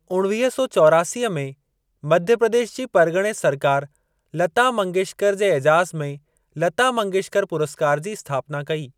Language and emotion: Sindhi, neutral